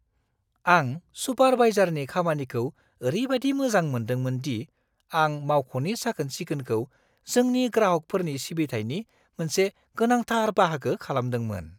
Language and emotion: Bodo, surprised